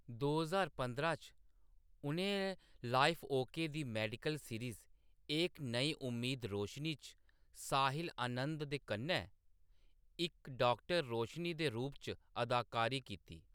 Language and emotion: Dogri, neutral